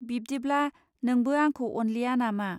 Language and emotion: Bodo, neutral